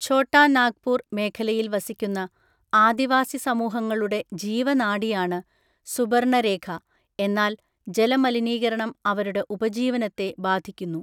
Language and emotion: Malayalam, neutral